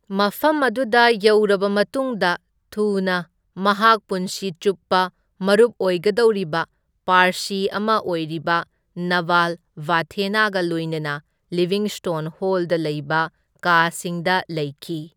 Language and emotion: Manipuri, neutral